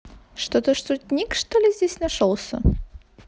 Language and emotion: Russian, positive